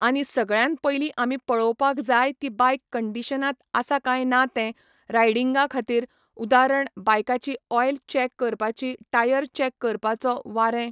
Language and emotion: Goan Konkani, neutral